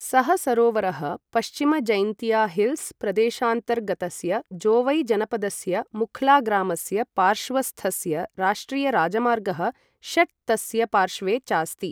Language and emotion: Sanskrit, neutral